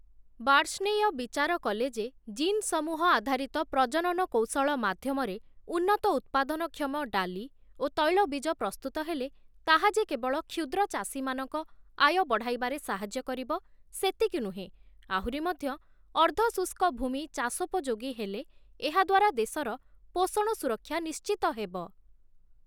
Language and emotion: Odia, neutral